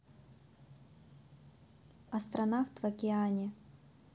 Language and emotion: Russian, neutral